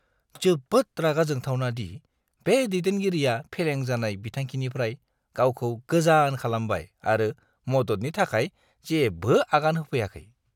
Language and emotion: Bodo, disgusted